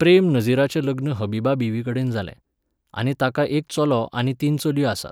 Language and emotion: Goan Konkani, neutral